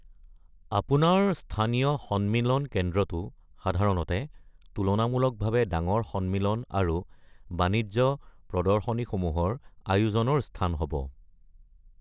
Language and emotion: Assamese, neutral